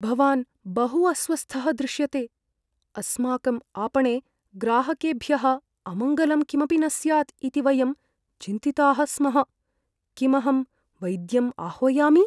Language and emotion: Sanskrit, fearful